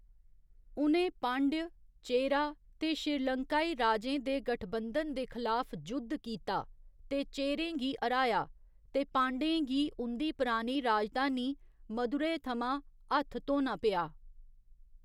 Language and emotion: Dogri, neutral